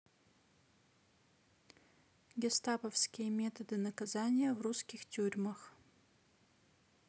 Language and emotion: Russian, neutral